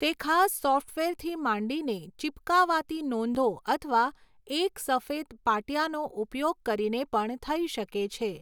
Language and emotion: Gujarati, neutral